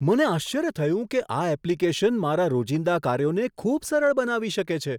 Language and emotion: Gujarati, surprised